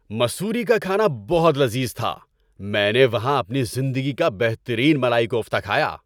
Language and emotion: Urdu, happy